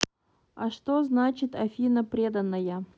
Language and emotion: Russian, neutral